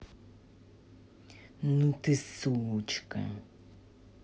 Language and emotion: Russian, angry